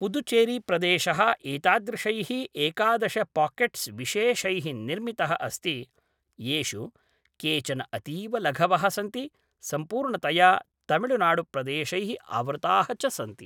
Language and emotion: Sanskrit, neutral